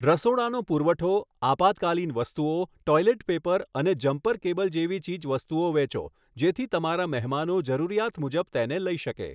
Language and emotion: Gujarati, neutral